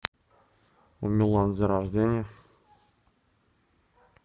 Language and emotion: Russian, neutral